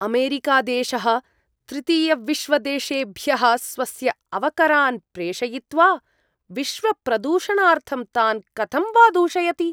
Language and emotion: Sanskrit, disgusted